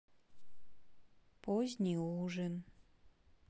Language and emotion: Russian, sad